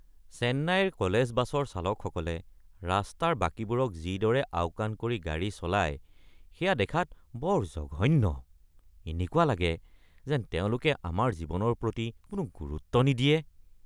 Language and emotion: Assamese, disgusted